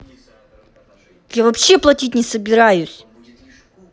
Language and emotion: Russian, angry